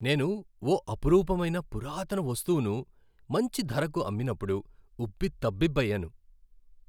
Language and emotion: Telugu, happy